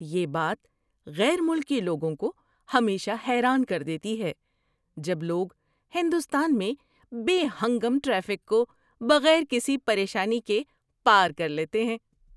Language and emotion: Urdu, surprised